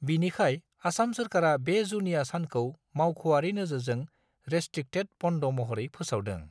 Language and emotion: Bodo, neutral